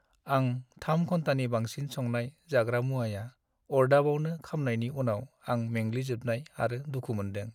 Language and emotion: Bodo, sad